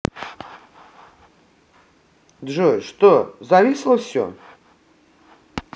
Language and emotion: Russian, neutral